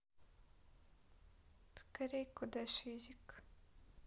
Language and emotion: Russian, sad